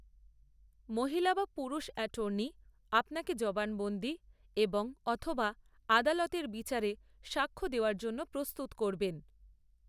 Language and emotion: Bengali, neutral